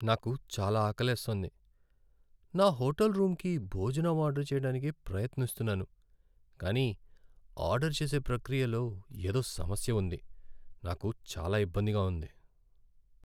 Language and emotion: Telugu, sad